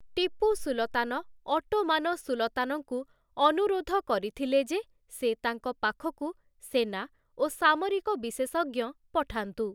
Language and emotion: Odia, neutral